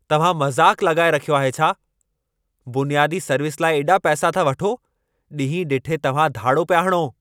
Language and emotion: Sindhi, angry